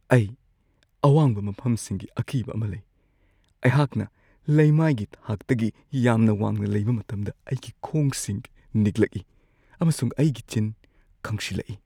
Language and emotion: Manipuri, fearful